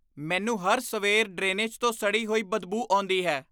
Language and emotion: Punjabi, disgusted